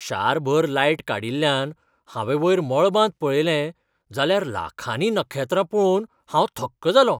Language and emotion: Goan Konkani, surprised